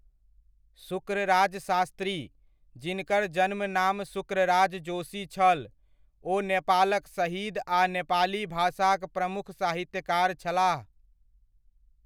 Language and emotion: Maithili, neutral